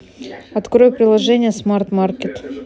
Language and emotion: Russian, neutral